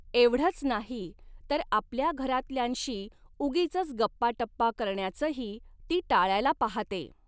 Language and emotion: Marathi, neutral